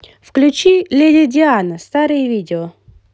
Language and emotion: Russian, positive